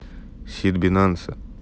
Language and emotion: Russian, neutral